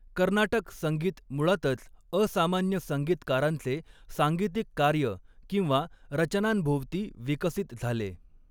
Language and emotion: Marathi, neutral